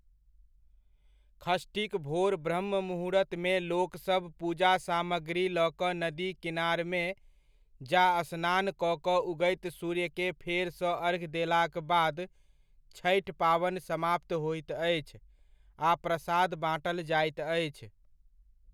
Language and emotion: Maithili, neutral